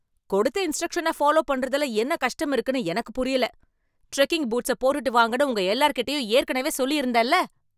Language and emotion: Tamil, angry